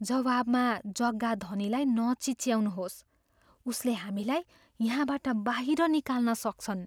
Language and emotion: Nepali, fearful